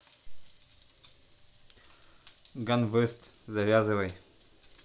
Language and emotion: Russian, neutral